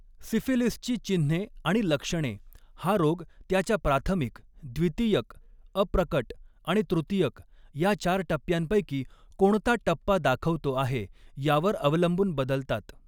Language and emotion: Marathi, neutral